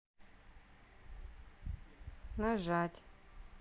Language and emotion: Russian, sad